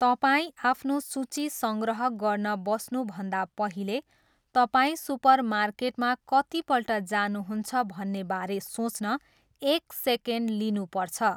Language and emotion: Nepali, neutral